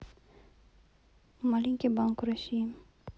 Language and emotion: Russian, neutral